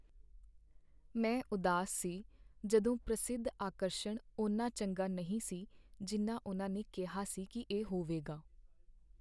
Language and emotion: Punjabi, sad